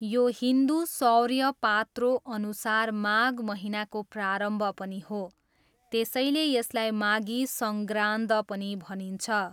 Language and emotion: Nepali, neutral